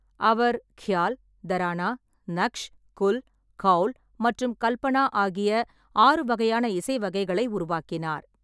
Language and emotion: Tamil, neutral